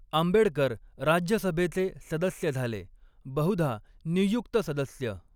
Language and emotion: Marathi, neutral